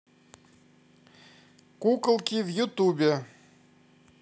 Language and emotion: Russian, positive